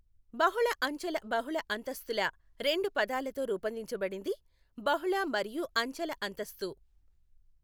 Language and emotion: Telugu, neutral